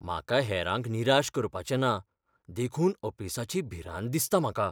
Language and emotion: Goan Konkani, fearful